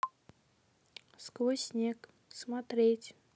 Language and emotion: Russian, neutral